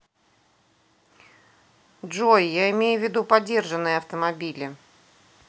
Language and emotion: Russian, neutral